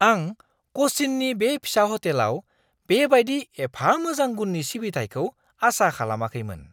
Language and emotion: Bodo, surprised